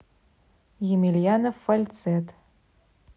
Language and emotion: Russian, neutral